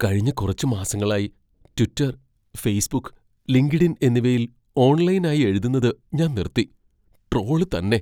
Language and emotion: Malayalam, fearful